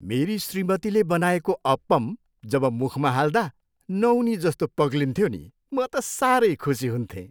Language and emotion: Nepali, happy